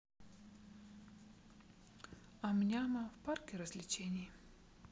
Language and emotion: Russian, sad